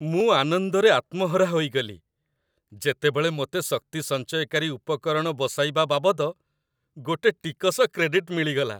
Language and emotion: Odia, happy